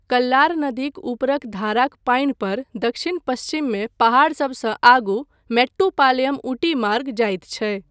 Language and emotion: Maithili, neutral